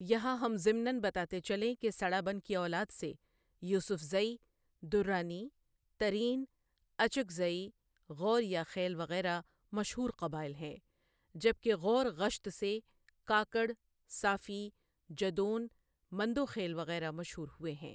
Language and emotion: Urdu, neutral